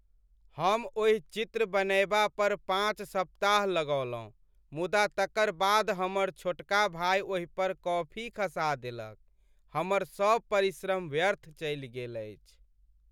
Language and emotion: Maithili, sad